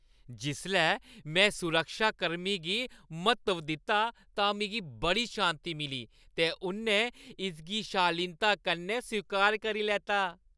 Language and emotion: Dogri, happy